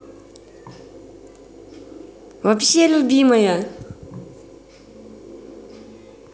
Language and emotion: Russian, positive